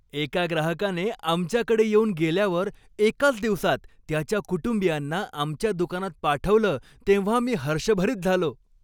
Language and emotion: Marathi, happy